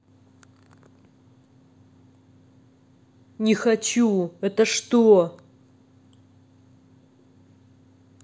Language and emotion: Russian, angry